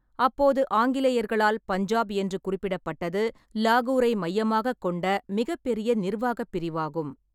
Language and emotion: Tamil, neutral